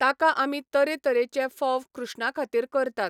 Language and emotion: Goan Konkani, neutral